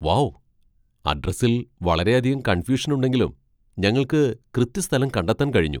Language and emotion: Malayalam, surprised